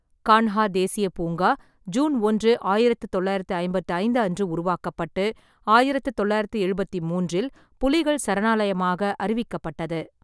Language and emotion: Tamil, neutral